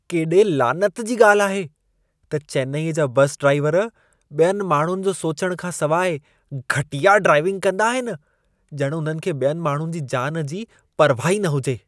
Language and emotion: Sindhi, disgusted